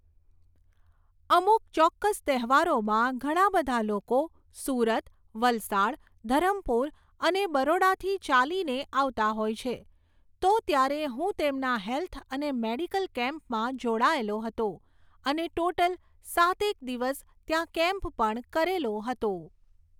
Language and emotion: Gujarati, neutral